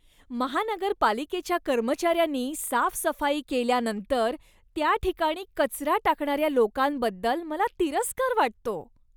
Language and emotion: Marathi, disgusted